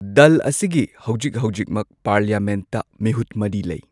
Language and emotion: Manipuri, neutral